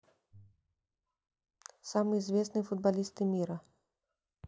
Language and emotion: Russian, neutral